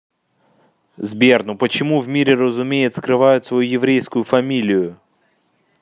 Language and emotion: Russian, neutral